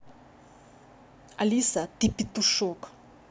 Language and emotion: Russian, angry